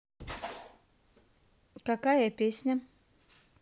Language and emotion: Russian, neutral